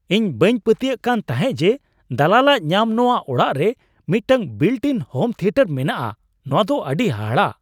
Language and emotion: Santali, surprised